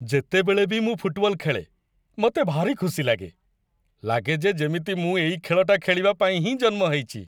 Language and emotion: Odia, happy